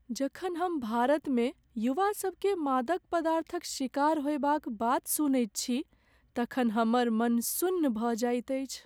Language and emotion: Maithili, sad